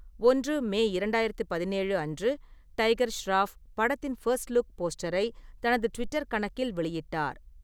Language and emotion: Tamil, neutral